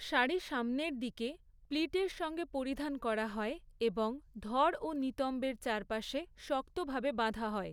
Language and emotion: Bengali, neutral